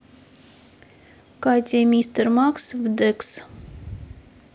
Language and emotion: Russian, neutral